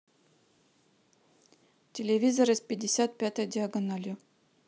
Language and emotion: Russian, neutral